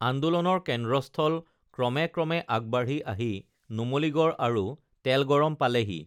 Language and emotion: Assamese, neutral